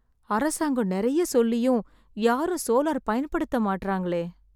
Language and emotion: Tamil, sad